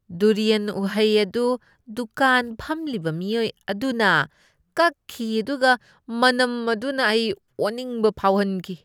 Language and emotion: Manipuri, disgusted